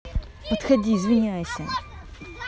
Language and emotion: Russian, angry